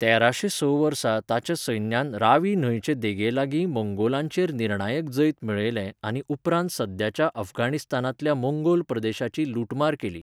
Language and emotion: Goan Konkani, neutral